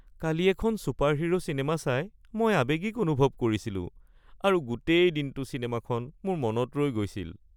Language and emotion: Assamese, sad